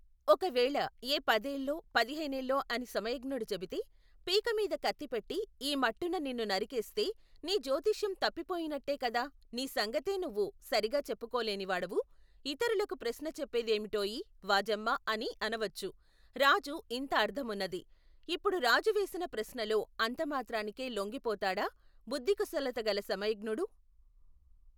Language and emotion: Telugu, neutral